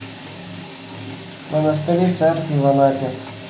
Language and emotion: Russian, neutral